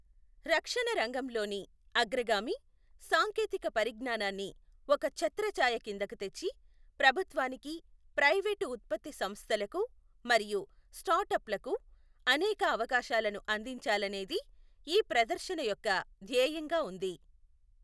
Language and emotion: Telugu, neutral